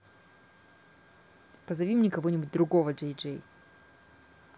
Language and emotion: Russian, angry